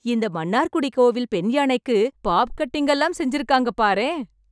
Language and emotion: Tamil, happy